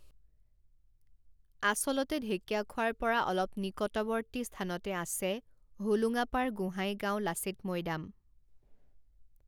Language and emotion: Assamese, neutral